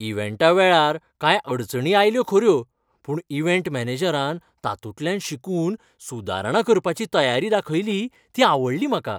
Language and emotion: Goan Konkani, happy